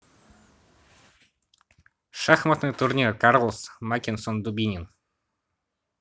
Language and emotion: Russian, neutral